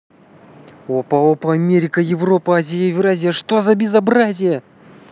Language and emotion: Russian, positive